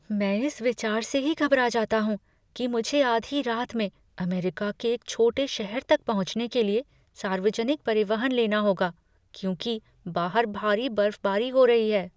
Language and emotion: Hindi, fearful